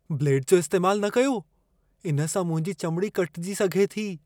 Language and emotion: Sindhi, fearful